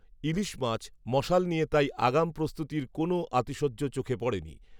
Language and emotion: Bengali, neutral